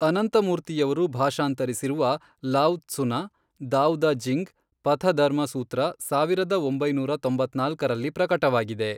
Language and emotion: Kannada, neutral